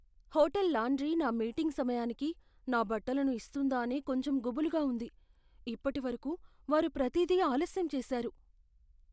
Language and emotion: Telugu, fearful